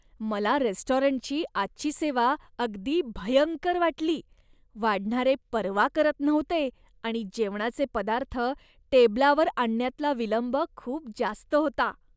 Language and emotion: Marathi, disgusted